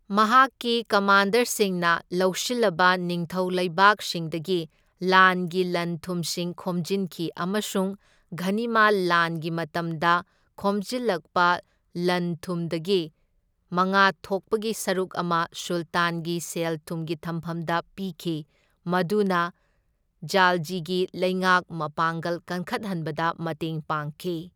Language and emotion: Manipuri, neutral